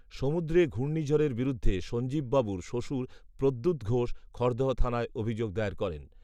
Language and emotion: Bengali, neutral